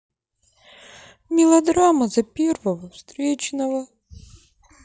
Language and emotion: Russian, sad